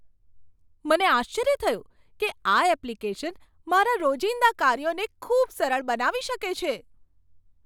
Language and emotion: Gujarati, surprised